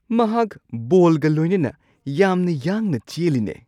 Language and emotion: Manipuri, surprised